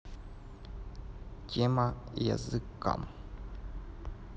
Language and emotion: Russian, neutral